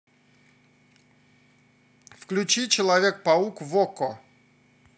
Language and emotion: Russian, positive